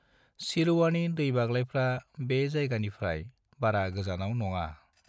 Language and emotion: Bodo, neutral